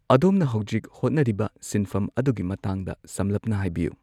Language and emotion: Manipuri, neutral